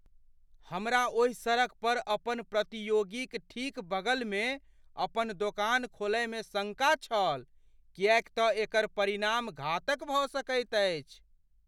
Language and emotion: Maithili, fearful